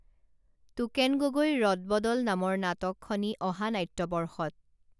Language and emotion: Assamese, neutral